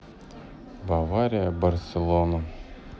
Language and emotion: Russian, sad